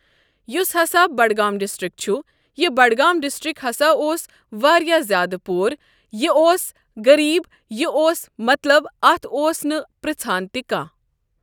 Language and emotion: Kashmiri, neutral